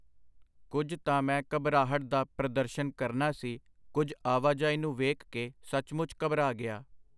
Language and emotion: Punjabi, neutral